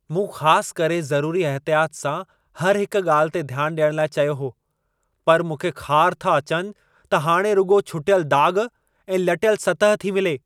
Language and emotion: Sindhi, angry